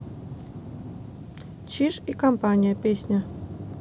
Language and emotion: Russian, neutral